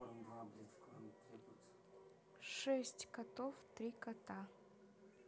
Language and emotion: Russian, neutral